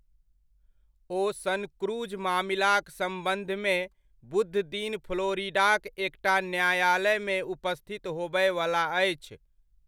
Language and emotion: Maithili, neutral